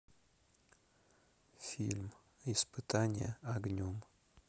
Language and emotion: Russian, neutral